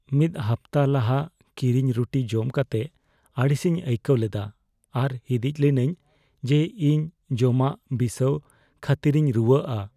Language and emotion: Santali, fearful